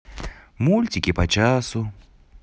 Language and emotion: Russian, positive